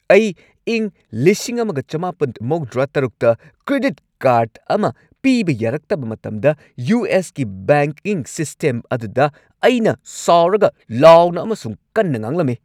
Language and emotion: Manipuri, angry